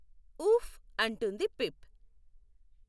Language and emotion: Telugu, neutral